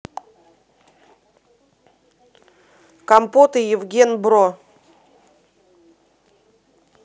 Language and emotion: Russian, neutral